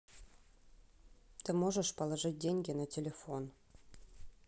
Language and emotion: Russian, neutral